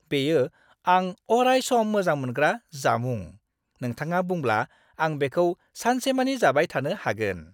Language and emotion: Bodo, happy